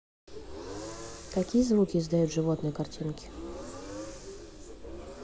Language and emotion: Russian, neutral